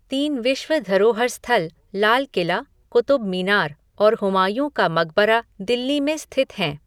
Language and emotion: Hindi, neutral